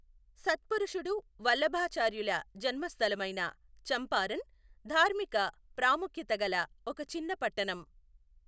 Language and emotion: Telugu, neutral